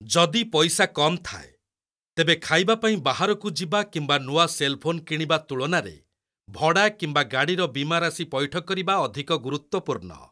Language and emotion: Odia, neutral